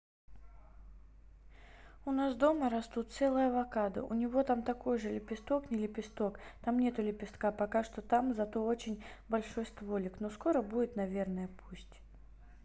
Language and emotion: Russian, neutral